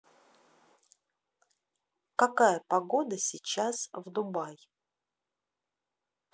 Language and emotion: Russian, neutral